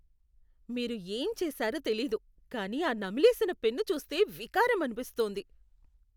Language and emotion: Telugu, disgusted